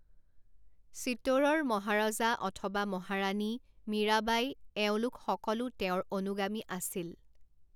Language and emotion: Assamese, neutral